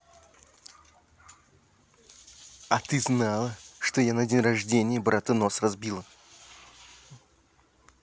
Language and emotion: Russian, angry